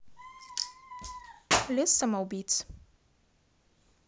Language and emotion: Russian, neutral